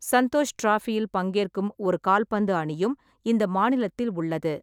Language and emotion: Tamil, neutral